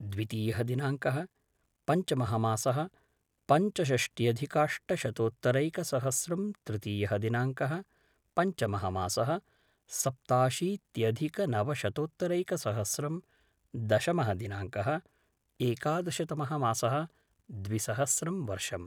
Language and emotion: Sanskrit, neutral